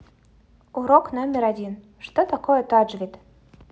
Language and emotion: Russian, neutral